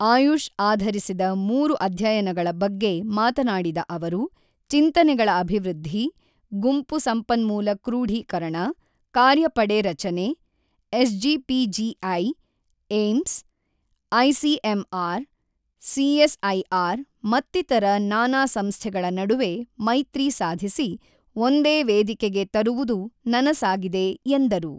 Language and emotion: Kannada, neutral